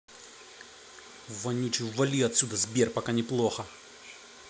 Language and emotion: Russian, angry